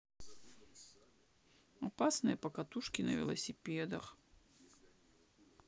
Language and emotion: Russian, sad